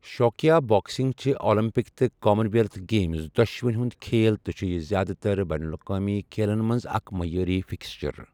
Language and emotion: Kashmiri, neutral